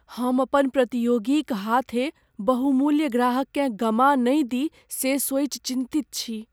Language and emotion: Maithili, fearful